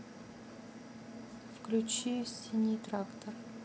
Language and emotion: Russian, neutral